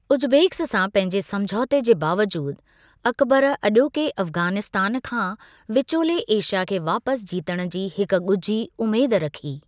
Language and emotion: Sindhi, neutral